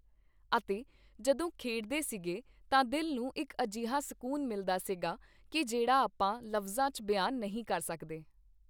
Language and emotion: Punjabi, neutral